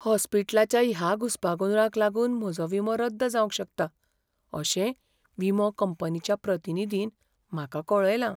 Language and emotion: Goan Konkani, fearful